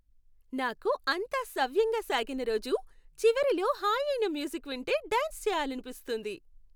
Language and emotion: Telugu, happy